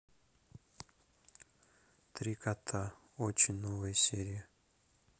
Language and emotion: Russian, neutral